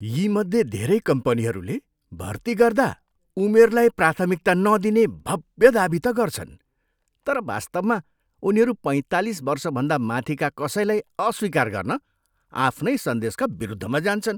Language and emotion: Nepali, disgusted